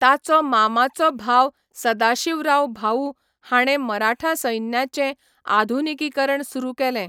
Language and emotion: Goan Konkani, neutral